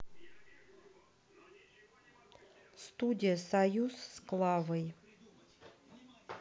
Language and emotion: Russian, neutral